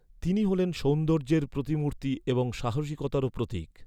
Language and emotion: Bengali, neutral